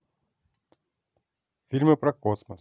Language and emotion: Russian, neutral